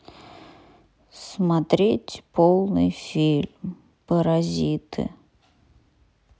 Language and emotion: Russian, sad